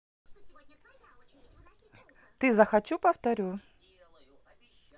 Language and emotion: Russian, neutral